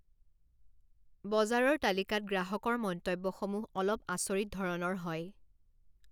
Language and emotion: Assamese, neutral